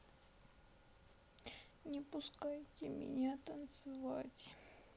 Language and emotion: Russian, sad